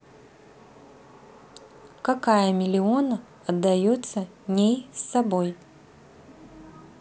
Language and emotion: Russian, neutral